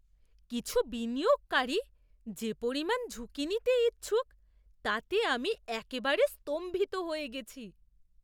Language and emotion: Bengali, surprised